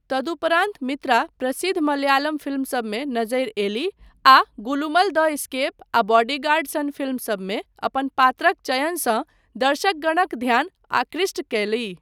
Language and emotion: Maithili, neutral